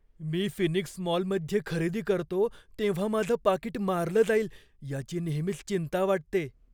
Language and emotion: Marathi, fearful